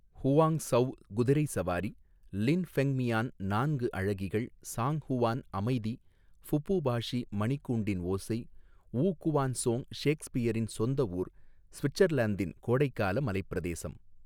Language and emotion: Tamil, neutral